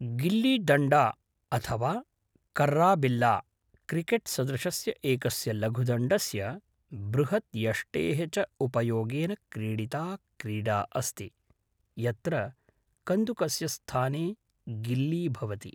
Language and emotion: Sanskrit, neutral